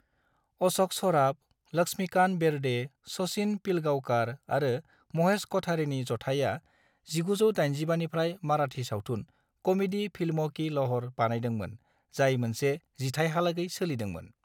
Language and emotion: Bodo, neutral